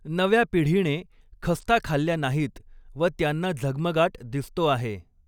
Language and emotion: Marathi, neutral